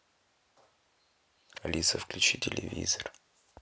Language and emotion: Russian, neutral